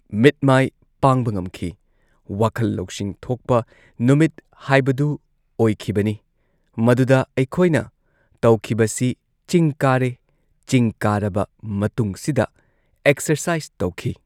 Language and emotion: Manipuri, neutral